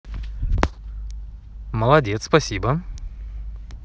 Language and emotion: Russian, positive